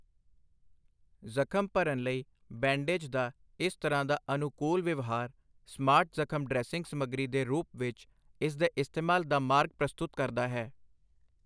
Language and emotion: Punjabi, neutral